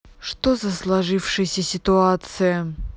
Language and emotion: Russian, angry